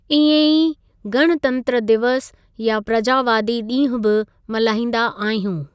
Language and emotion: Sindhi, neutral